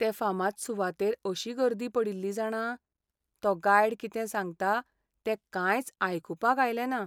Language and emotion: Goan Konkani, sad